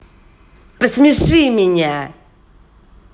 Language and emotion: Russian, angry